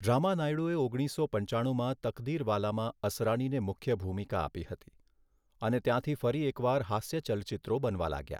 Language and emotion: Gujarati, neutral